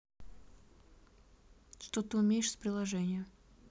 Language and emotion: Russian, neutral